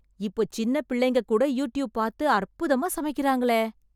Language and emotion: Tamil, surprised